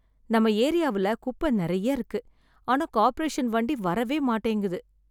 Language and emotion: Tamil, sad